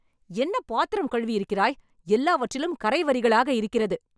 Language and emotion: Tamil, angry